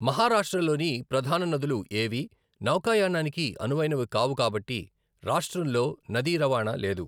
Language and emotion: Telugu, neutral